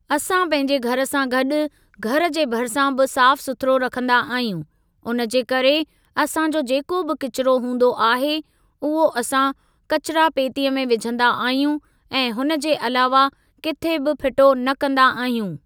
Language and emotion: Sindhi, neutral